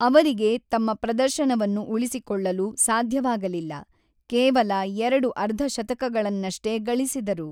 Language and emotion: Kannada, neutral